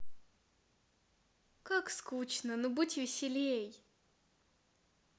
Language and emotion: Russian, positive